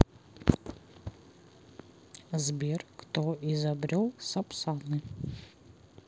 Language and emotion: Russian, neutral